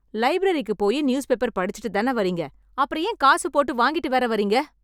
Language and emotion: Tamil, angry